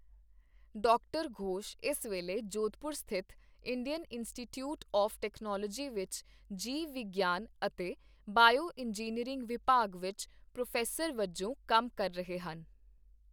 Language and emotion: Punjabi, neutral